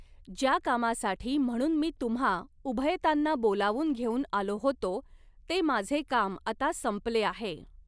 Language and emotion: Marathi, neutral